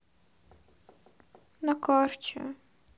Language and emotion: Russian, sad